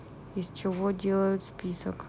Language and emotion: Russian, neutral